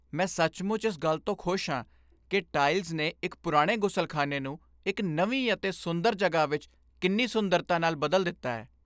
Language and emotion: Punjabi, happy